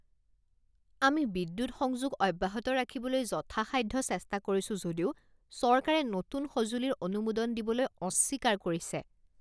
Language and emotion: Assamese, disgusted